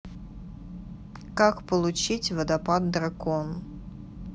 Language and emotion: Russian, neutral